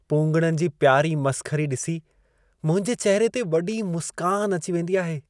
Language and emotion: Sindhi, happy